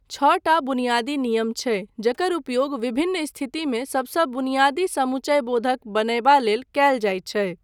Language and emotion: Maithili, neutral